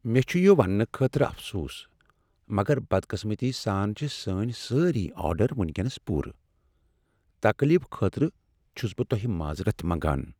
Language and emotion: Kashmiri, sad